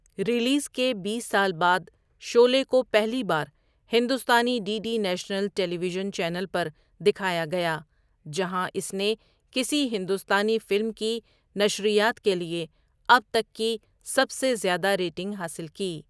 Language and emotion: Urdu, neutral